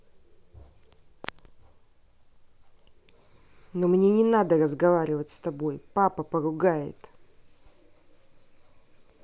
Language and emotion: Russian, angry